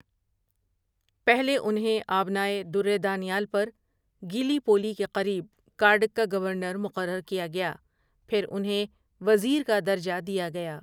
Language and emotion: Urdu, neutral